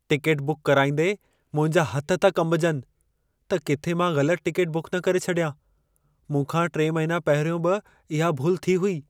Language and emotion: Sindhi, fearful